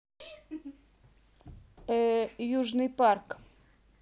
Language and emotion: Russian, neutral